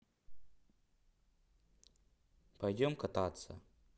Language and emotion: Russian, neutral